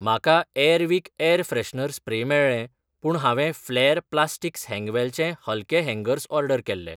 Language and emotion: Goan Konkani, neutral